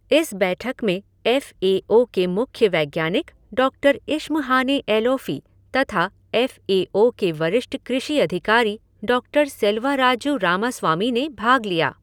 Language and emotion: Hindi, neutral